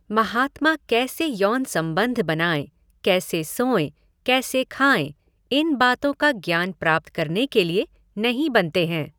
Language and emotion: Hindi, neutral